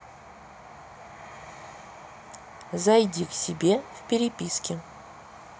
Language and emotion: Russian, neutral